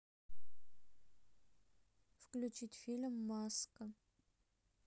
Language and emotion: Russian, neutral